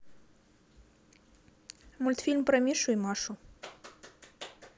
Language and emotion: Russian, neutral